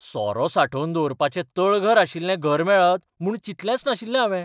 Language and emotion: Goan Konkani, surprised